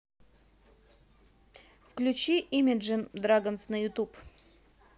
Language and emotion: Russian, neutral